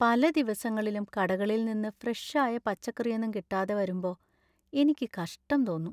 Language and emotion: Malayalam, sad